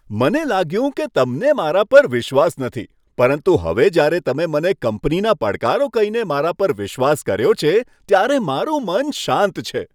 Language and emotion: Gujarati, happy